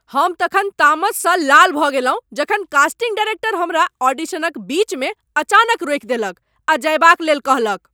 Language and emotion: Maithili, angry